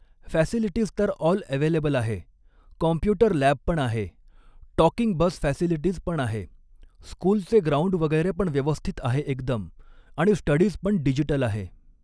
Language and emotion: Marathi, neutral